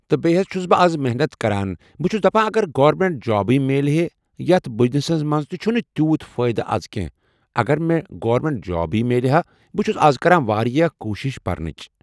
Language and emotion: Kashmiri, neutral